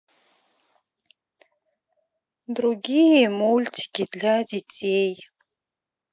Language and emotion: Russian, sad